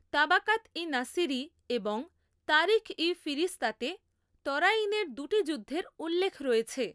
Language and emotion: Bengali, neutral